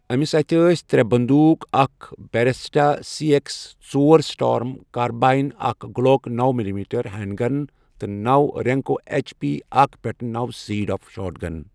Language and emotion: Kashmiri, neutral